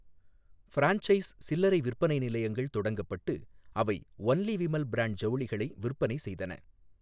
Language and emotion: Tamil, neutral